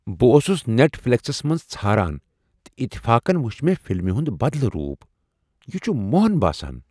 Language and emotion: Kashmiri, surprised